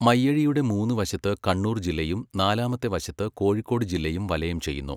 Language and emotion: Malayalam, neutral